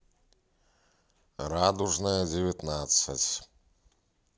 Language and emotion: Russian, neutral